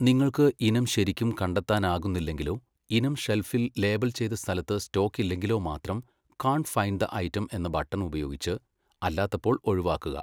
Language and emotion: Malayalam, neutral